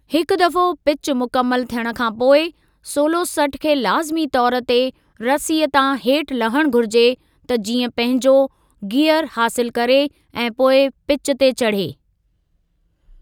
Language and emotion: Sindhi, neutral